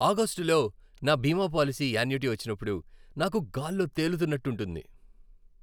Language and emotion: Telugu, happy